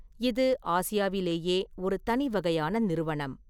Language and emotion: Tamil, neutral